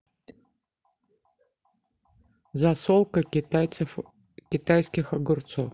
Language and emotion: Russian, neutral